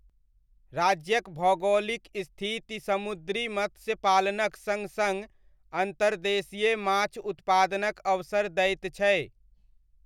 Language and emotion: Maithili, neutral